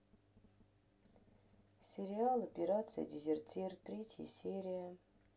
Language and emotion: Russian, sad